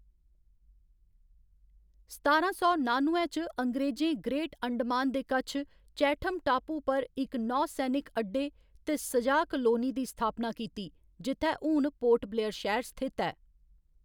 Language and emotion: Dogri, neutral